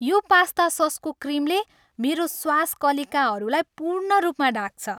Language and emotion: Nepali, happy